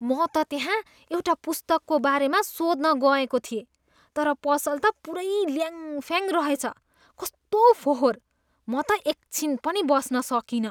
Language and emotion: Nepali, disgusted